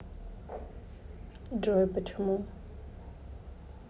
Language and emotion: Russian, neutral